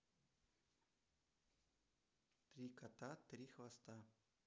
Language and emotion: Russian, neutral